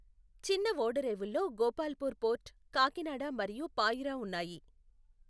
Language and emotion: Telugu, neutral